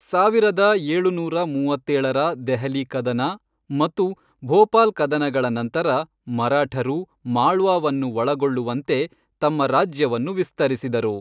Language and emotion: Kannada, neutral